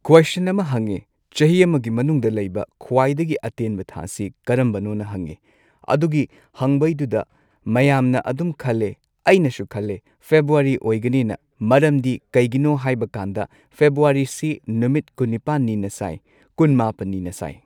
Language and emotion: Manipuri, neutral